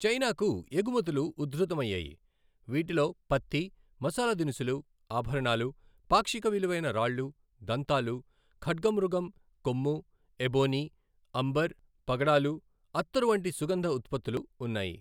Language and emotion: Telugu, neutral